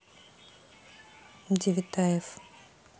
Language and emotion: Russian, neutral